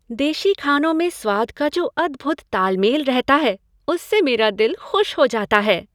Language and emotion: Hindi, happy